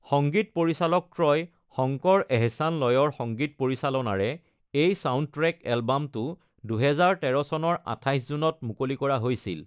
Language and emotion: Assamese, neutral